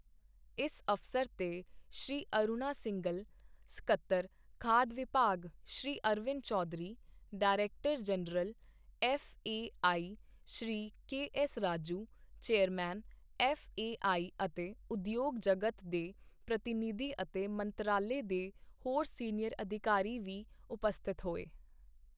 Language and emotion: Punjabi, neutral